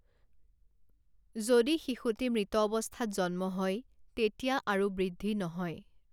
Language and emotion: Assamese, neutral